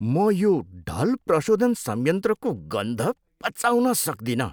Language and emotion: Nepali, disgusted